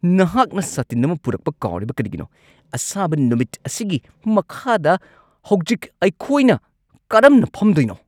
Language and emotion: Manipuri, angry